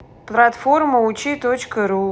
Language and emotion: Russian, neutral